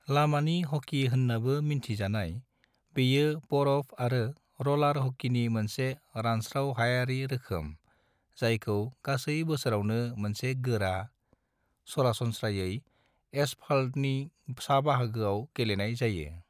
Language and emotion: Bodo, neutral